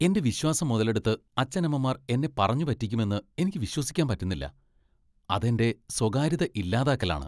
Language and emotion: Malayalam, disgusted